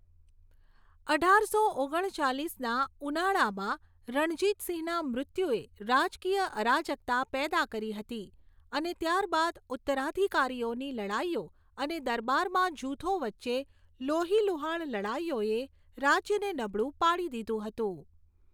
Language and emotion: Gujarati, neutral